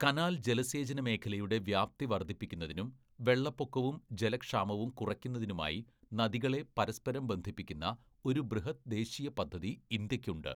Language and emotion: Malayalam, neutral